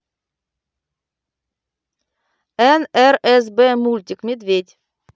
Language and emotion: Russian, neutral